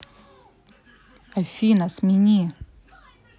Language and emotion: Russian, neutral